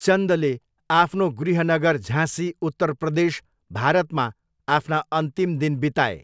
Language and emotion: Nepali, neutral